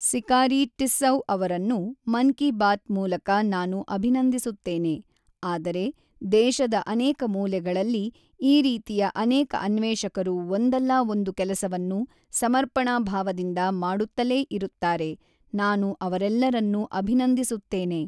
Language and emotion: Kannada, neutral